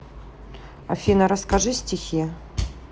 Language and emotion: Russian, neutral